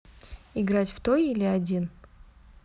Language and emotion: Russian, neutral